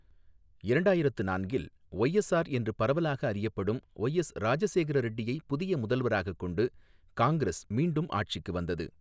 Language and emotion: Tamil, neutral